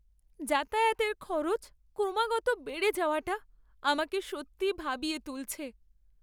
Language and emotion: Bengali, sad